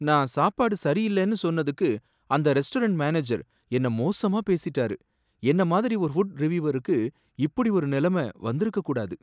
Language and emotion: Tamil, sad